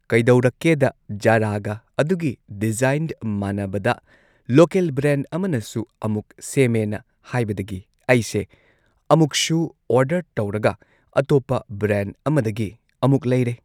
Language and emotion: Manipuri, neutral